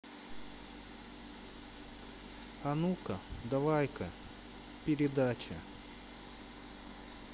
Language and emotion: Russian, sad